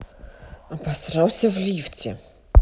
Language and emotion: Russian, angry